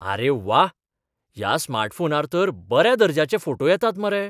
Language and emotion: Goan Konkani, surprised